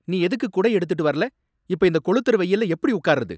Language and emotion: Tamil, angry